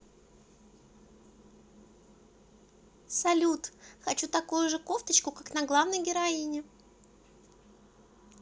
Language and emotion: Russian, positive